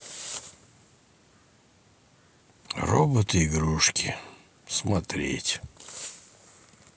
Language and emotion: Russian, sad